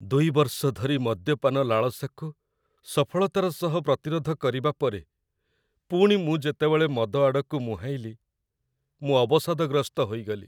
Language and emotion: Odia, sad